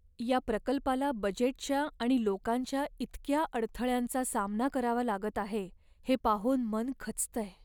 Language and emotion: Marathi, sad